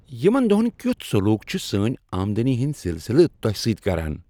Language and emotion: Kashmiri, happy